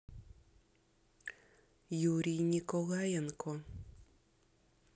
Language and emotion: Russian, neutral